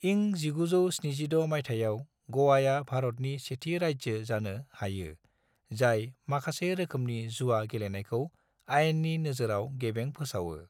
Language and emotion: Bodo, neutral